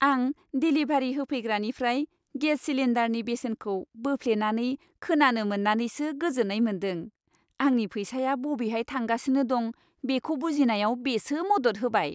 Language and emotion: Bodo, happy